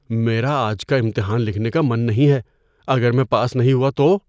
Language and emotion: Urdu, fearful